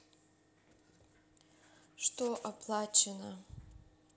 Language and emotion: Russian, neutral